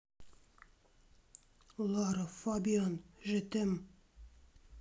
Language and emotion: Russian, neutral